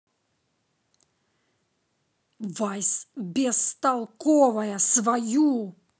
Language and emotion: Russian, angry